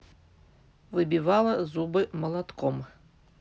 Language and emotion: Russian, neutral